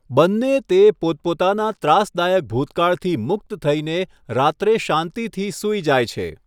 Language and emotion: Gujarati, neutral